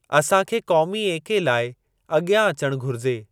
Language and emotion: Sindhi, neutral